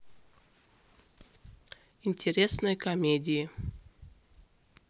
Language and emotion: Russian, neutral